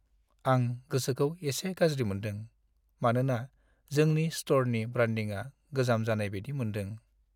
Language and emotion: Bodo, sad